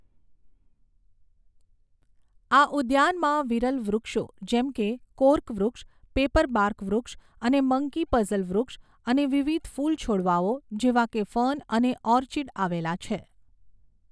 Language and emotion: Gujarati, neutral